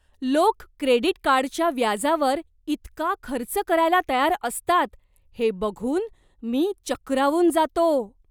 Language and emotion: Marathi, surprised